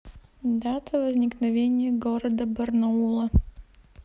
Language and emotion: Russian, neutral